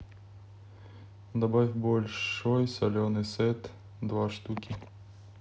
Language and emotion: Russian, neutral